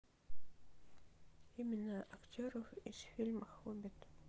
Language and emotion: Russian, sad